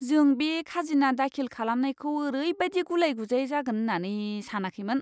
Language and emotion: Bodo, disgusted